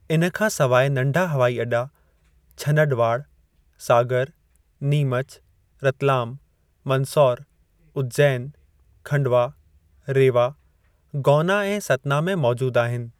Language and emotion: Sindhi, neutral